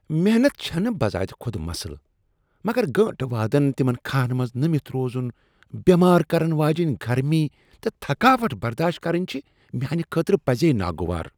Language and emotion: Kashmiri, disgusted